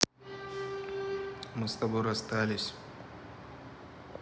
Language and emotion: Russian, neutral